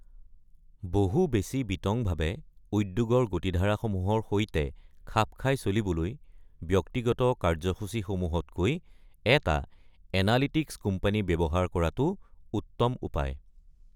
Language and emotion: Assamese, neutral